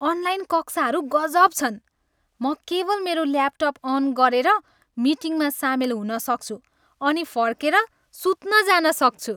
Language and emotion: Nepali, happy